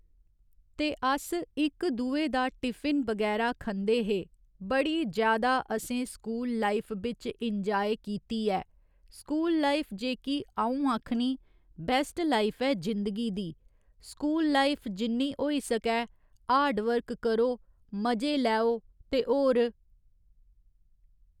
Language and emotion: Dogri, neutral